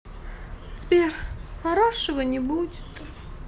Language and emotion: Russian, sad